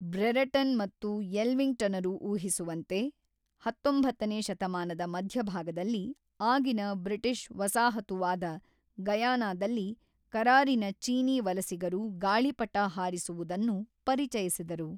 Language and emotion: Kannada, neutral